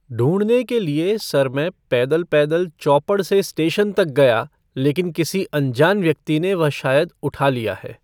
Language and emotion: Hindi, neutral